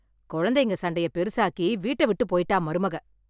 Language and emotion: Tamil, angry